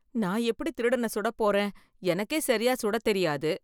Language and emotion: Tamil, fearful